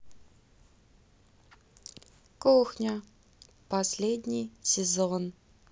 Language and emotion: Russian, neutral